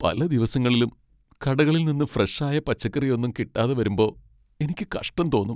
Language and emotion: Malayalam, sad